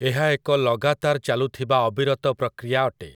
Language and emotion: Odia, neutral